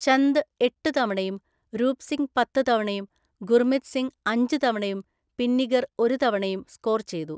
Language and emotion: Malayalam, neutral